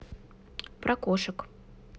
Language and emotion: Russian, neutral